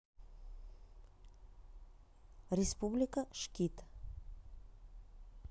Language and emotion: Russian, neutral